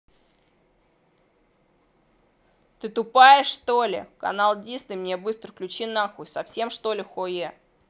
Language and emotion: Russian, angry